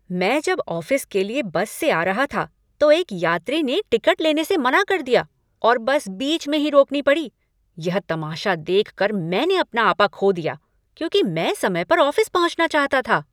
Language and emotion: Hindi, angry